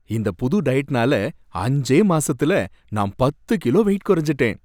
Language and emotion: Tamil, happy